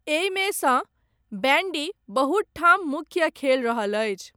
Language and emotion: Maithili, neutral